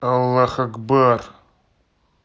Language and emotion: Russian, angry